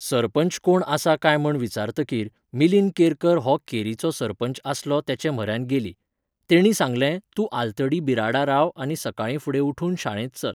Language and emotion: Goan Konkani, neutral